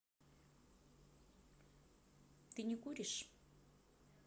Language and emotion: Russian, neutral